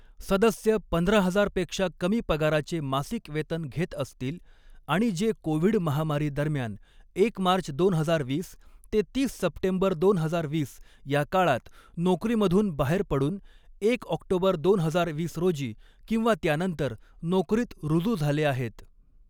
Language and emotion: Marathi, neutral